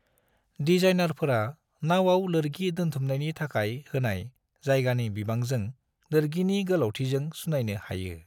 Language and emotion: Bodo, neutral